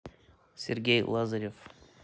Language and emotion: Russian, neutral